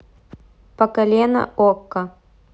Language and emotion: Russian, neutral